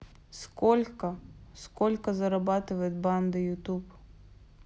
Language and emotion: Russian, neutral